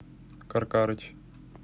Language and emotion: Russian, neutral